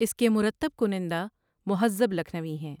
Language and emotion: Urdu, neutral